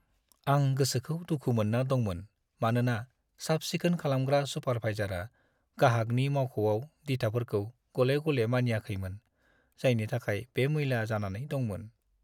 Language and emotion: Bodo, sad